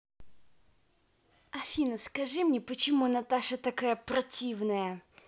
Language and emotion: Russian, angry